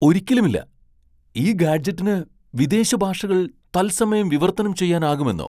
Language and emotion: Malayalam, surprised